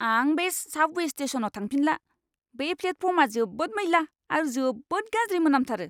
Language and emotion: Bodo, disgusted